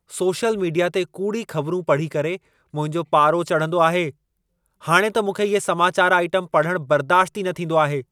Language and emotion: Sindhi, angry